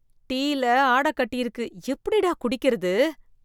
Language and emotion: Tamil, disgusted